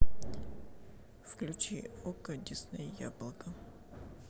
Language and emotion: Russian, neutral